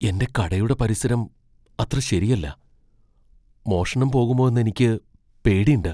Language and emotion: Malayalam, fearful